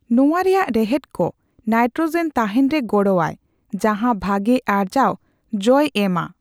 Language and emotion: Santali, neutral